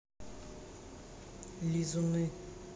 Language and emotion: Russian, neutral